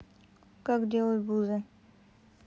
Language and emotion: Russian, neutral